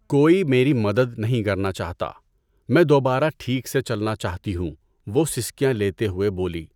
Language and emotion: Urdu, neutral